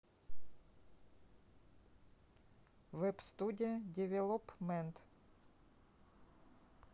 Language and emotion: Russian, neutral